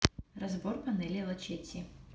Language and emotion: Russian, neutral